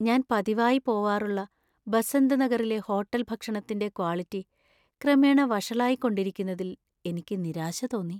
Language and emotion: Malayalam, sad